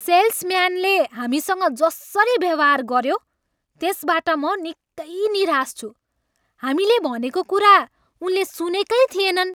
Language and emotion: Nepali, angry